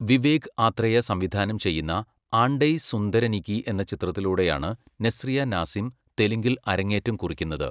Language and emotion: Malayalam, neutral